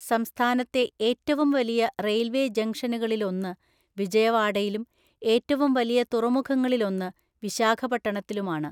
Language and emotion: Malayalam, neutral